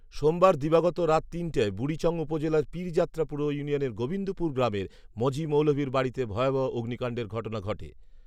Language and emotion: Bengali, neutral